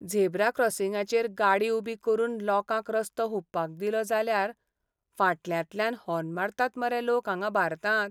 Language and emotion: Goan Konkani, sad